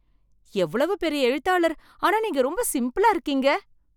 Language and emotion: Tamil, surprised